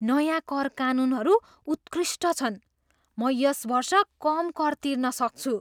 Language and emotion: Nepali, surprised